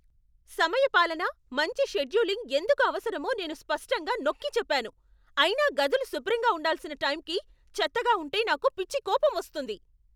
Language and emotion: Telugu, angry